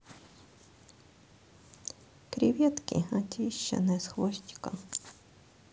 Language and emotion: Russian, sad